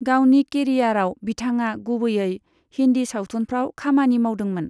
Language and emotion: Bodo, neutral